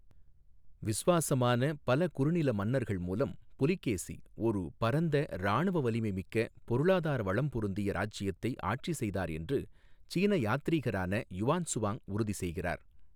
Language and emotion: Tamil, neutral